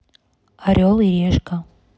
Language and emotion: Russian, neutral